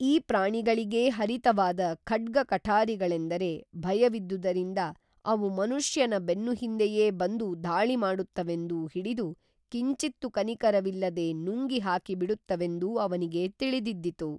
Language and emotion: Kannada, neutral